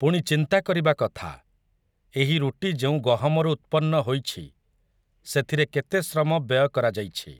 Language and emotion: Odia, neutral